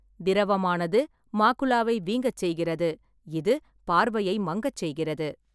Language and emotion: Tamil, neutral